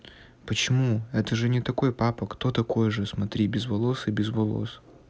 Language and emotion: Russian, neutral